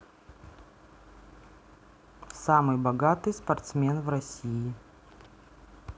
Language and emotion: Russian, neutral